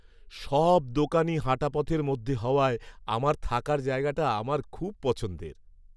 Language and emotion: Bengali, happy